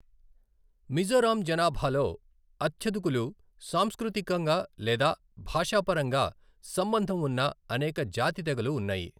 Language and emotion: Telugu, neutral